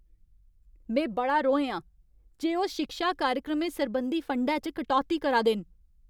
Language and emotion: Dogri, angry